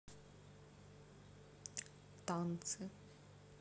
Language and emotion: Russian, neutral